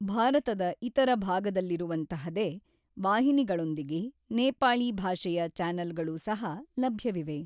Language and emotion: Kannada, neutral